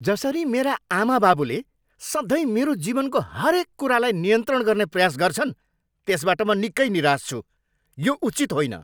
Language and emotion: Nepali, angry